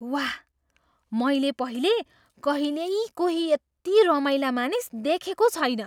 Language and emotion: Nepali, surprised